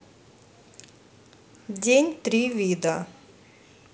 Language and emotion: Russian, neutral